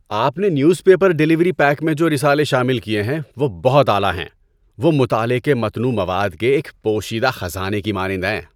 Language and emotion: Urdu, happy